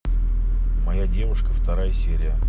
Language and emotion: Russian, neutral